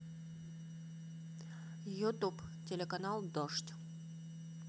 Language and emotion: Russian, neutral